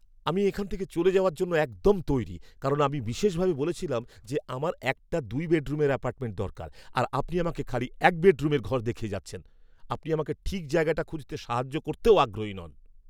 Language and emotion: Bengali, angry